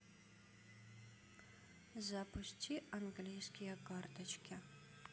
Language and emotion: Russian, neutral